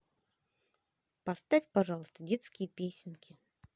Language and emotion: Russian, neutral